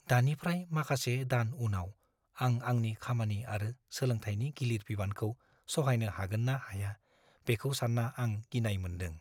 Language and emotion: Bodo, fearful